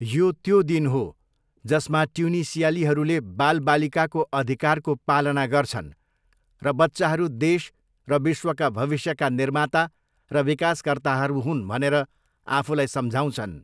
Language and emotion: Nepali, neutral